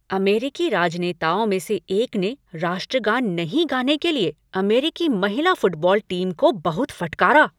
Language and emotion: Hindi, angry